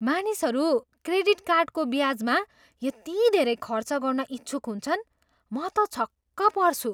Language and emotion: Nepali, surprised